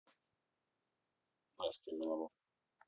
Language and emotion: Russian, neutral